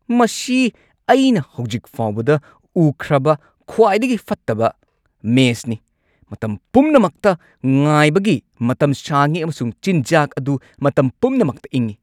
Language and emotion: Manipuri, angry